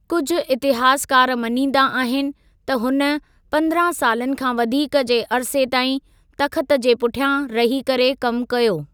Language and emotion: Sindhi, neutral